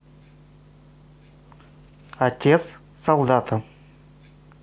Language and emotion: Russian, neutral